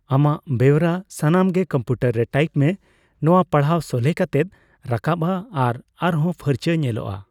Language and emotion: Santali, neutral